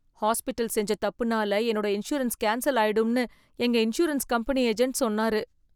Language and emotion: Tamil, fearful